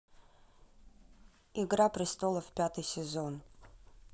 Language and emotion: Russian, neutral